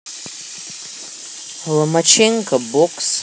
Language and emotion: Russian, neutral